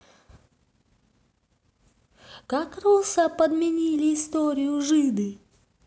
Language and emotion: Russian, neutral